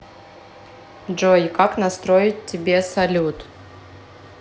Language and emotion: Russian, neutral